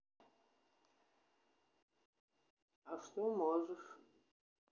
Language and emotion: Russian, neutral